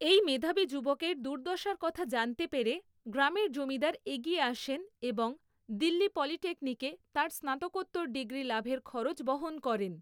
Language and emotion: Bengali, neutral